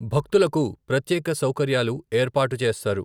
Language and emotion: Telugu, neutral